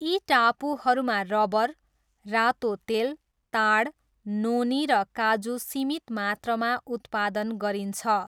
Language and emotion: Nepali, neutral